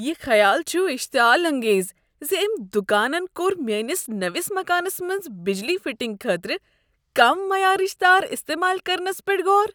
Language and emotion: Kashmiri, disgusted